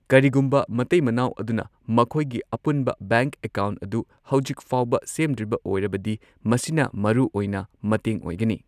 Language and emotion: Manipuri, neutral